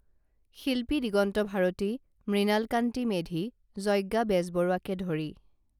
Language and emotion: Assamese, neutral